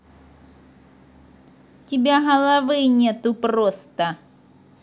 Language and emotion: Russian, angry